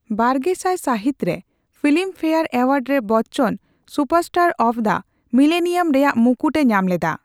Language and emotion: Santali, neutral